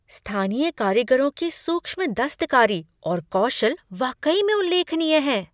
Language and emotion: Hindi, surprised